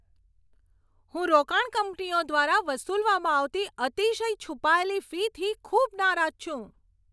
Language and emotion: Gujarati, angry